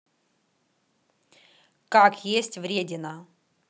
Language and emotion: Russian, neutral